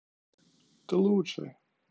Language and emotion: Russian, neutral